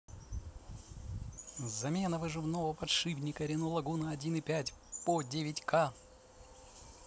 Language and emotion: Russian, positive